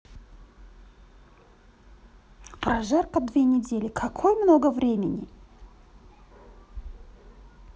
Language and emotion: Russian, neutral